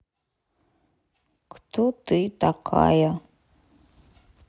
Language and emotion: Russian, neutral